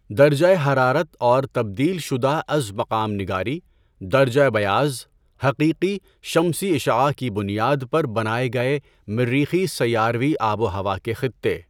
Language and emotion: Urdu, neutral